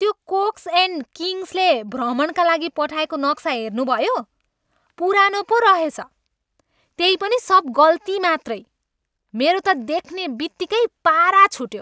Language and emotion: Nepali, angry